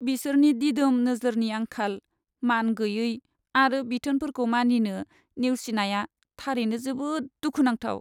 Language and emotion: Bodo, sad